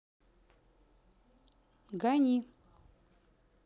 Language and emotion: Russian, neutral